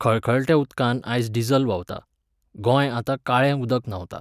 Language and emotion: Goan Konkani, neutral